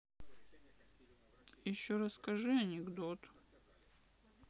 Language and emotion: Russian, sad